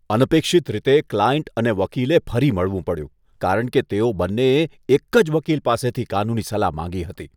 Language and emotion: Gujarati, disgusted